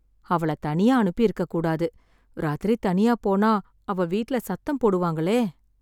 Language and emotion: Tamil, sad